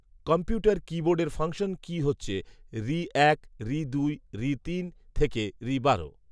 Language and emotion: Bengali, neutral